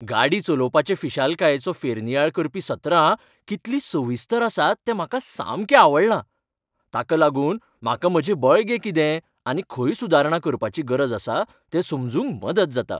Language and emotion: Goan Konkani, happy